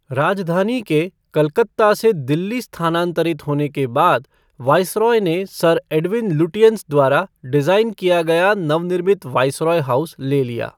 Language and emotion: Hindi, neutral